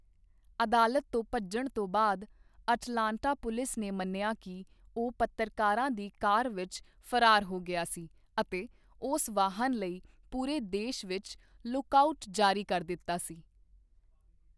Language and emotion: Punjabi, neutral